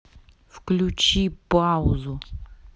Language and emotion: Russian, angry